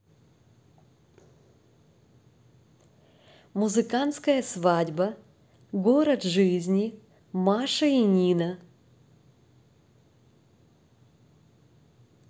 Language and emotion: Russian, positive